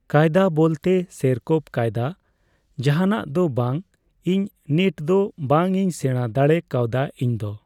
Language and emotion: Santali, neutral